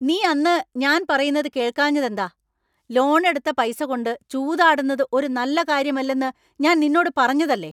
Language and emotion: Malayalam, angry